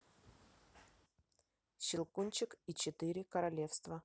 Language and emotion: Russian, neutral